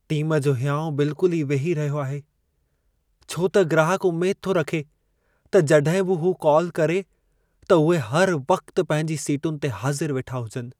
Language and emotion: Sindhi, sad